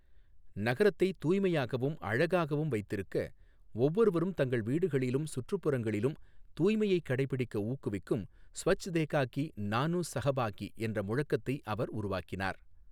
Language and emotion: Tamil, neutral